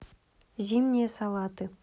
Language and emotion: Russian, neutral